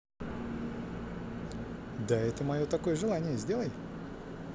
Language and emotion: Russian, positive